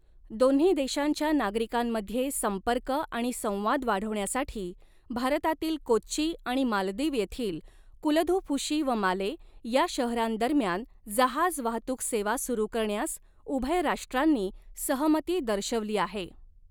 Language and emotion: Marathi, neutral